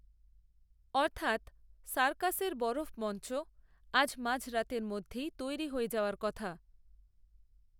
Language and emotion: Bengali, neutral